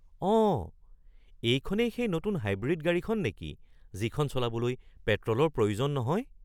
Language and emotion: Assamese, surprised